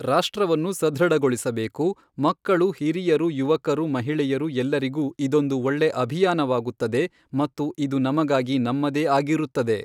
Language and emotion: Kannada, neutral